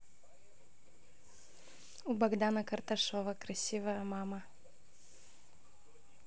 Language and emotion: Russian, positive